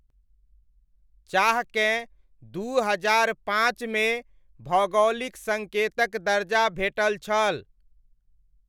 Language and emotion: Maithili, neutral